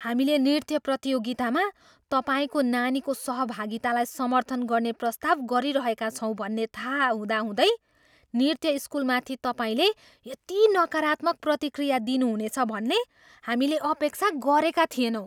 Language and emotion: Nepali, surprised